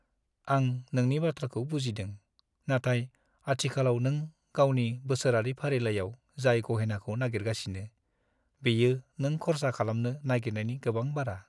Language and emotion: Bodo, sad